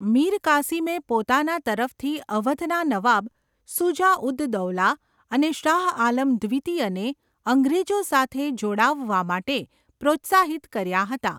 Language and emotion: Gujarati, neutral